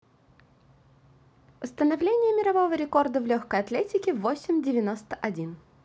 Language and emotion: Russian, positive